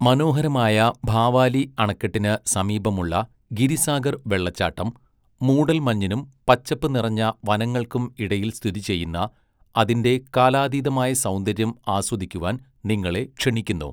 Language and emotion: Malayalam, neutral